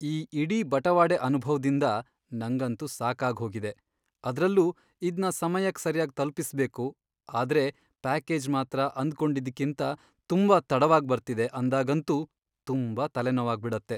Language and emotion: Kannada, sad